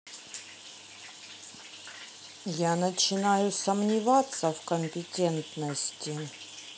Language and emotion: Russian, angry